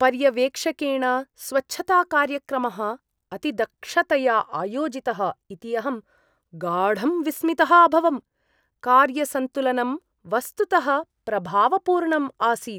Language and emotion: Sanskrit, surprised